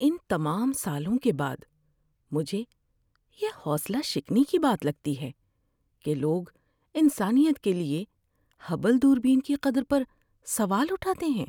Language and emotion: Urdu, sad